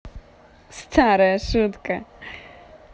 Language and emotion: Russian, positive